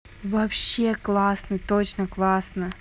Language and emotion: Russian, positive